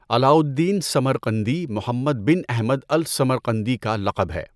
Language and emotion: Urdu, neutral